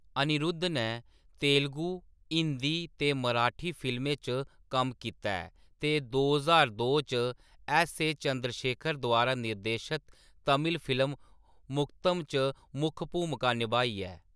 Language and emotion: Dogri, neutral